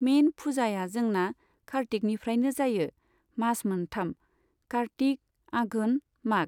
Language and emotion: Bodo, neutral